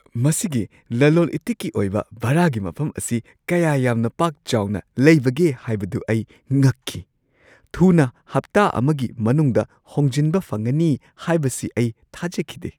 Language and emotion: Manipuri, surprised